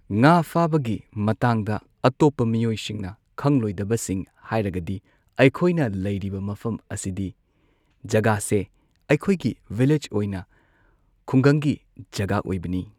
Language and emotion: Manipuri, neutral